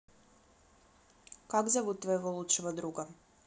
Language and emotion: Russian, neutral